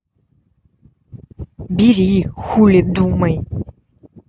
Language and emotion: Russian, angry